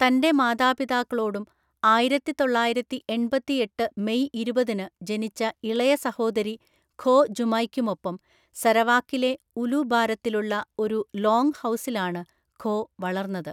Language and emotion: Malayalam, neutral